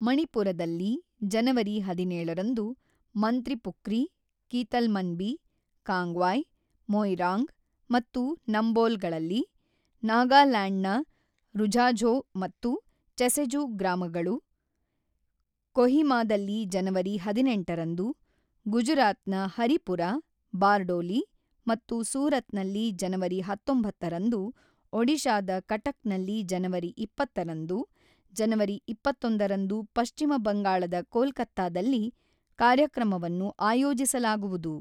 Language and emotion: Kannada, neutral